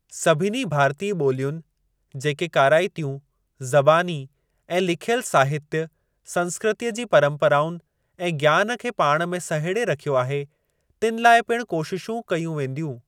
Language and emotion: Sindhi, neutral